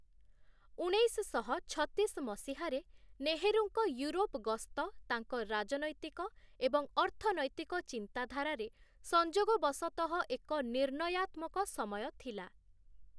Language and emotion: Odia, neutral